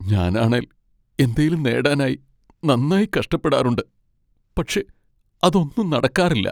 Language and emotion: Malayalam, sad